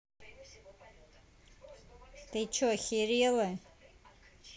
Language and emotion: Russian, angry